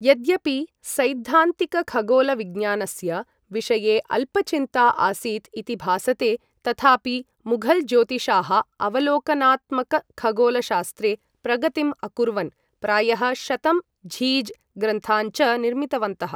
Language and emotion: Sanskrit, neutral